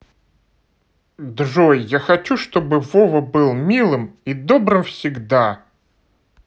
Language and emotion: Russian, positive